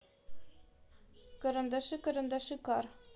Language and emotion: Russian, neutral